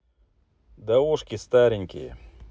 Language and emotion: Russian, neutral